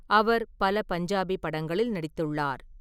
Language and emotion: Tamil, neutral